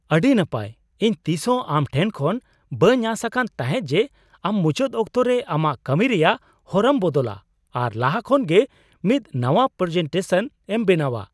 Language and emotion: Santali, surprised